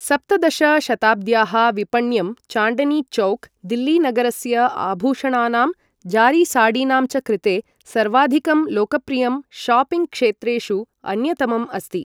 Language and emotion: Sanskrit, neutral